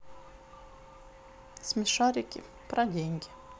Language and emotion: Russian, neutral